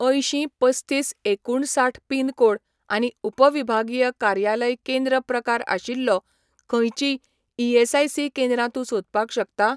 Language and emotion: Goan Konkani, neutral